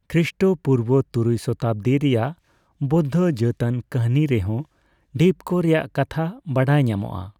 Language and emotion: Santali, neutral